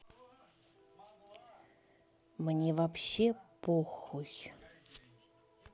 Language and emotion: Russian, neutral